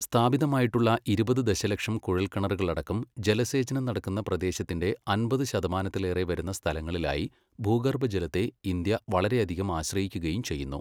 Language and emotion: Malayalam, neutral